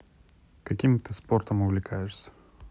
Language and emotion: Russian, neutral